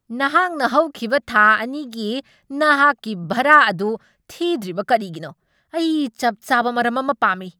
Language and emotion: Manipuri, angry